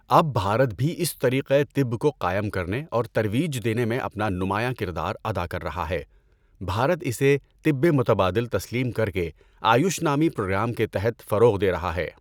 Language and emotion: Urdu, neutral